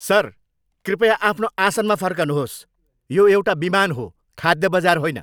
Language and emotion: Nepali, angry